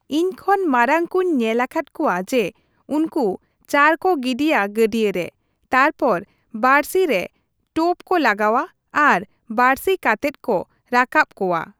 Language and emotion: Santali, neutral